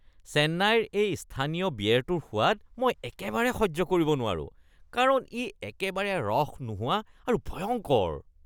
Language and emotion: Assamese, disgusted